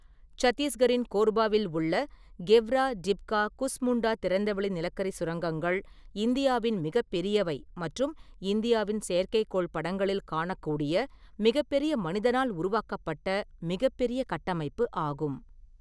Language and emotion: Tamil, neutral